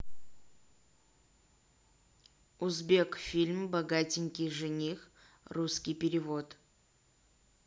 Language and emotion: Russian, neutral